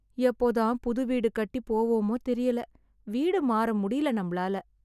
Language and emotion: Tamil, sad